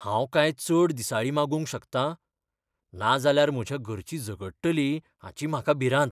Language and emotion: Goan Konkani, fearful